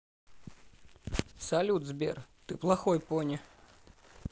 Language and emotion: Russian, neutral